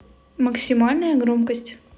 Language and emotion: Russian, neutral